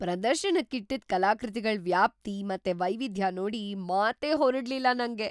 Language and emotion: Kannada, surprised